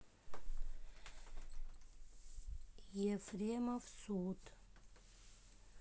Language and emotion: Russian, neutral